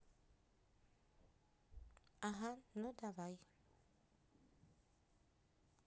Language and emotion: Russian, neutral